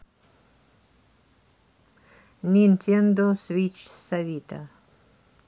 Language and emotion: Russian, neutral